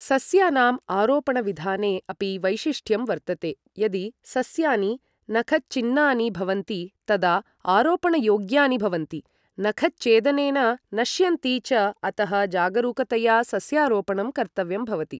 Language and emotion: Sanskrit, neutral